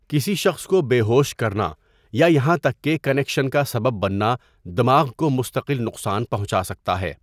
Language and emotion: Urdu, neutral